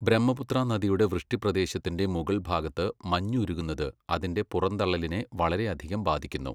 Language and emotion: Malayalam, neutral